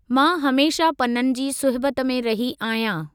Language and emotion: Sindhi, neutral